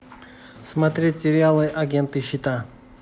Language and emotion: Russian, neutral